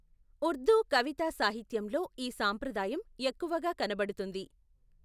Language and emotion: Telugu, neutral